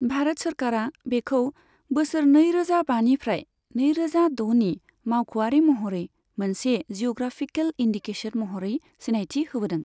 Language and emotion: Bodo, neutral